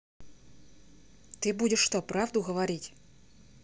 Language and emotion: Russian, neutral